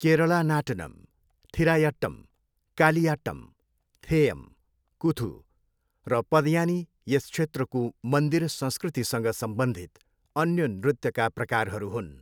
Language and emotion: Nepali, neutral